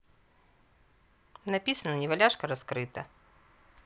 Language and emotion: Russian, neutral